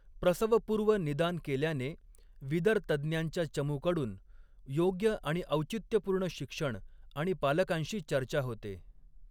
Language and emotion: Marathi, neutral